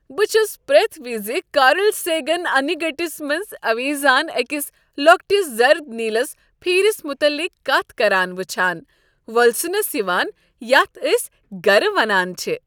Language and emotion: Kashmiri, happy